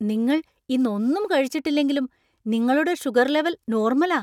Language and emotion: Malayalam, surprised